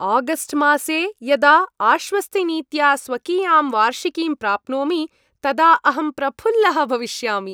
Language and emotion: Sanskrit, happy